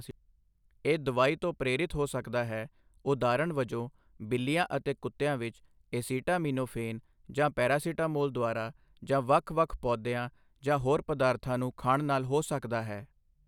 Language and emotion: Punjabi, neutral